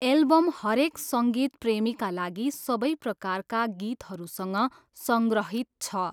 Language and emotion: Nepali, neutral